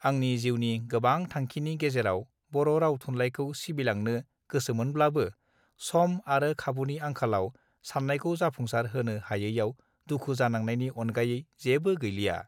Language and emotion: Bodo, neutral